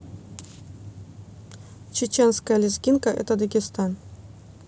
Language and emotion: Russian, neutral